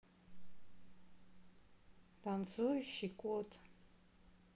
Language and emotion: Russian, neutral